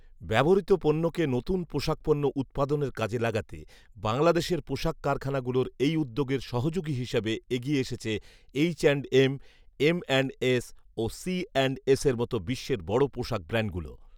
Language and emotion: Bengali, neutral